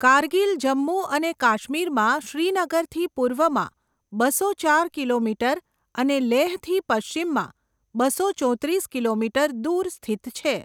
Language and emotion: Gujarati, neutral